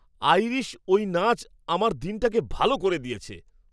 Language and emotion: Bengali, happy